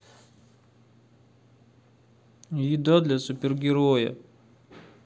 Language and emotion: Russian, sad